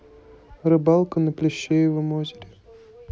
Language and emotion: Russian, neutral